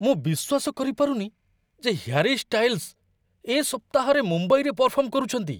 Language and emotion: Odia, surprised